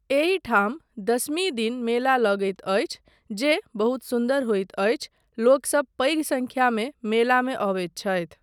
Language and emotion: Maithili, neutral